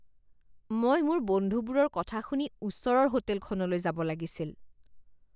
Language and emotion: Assamese, disgusted